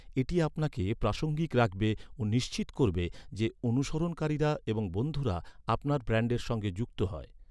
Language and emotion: Bengali, neutral